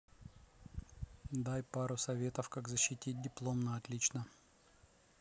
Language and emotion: Russian, neutral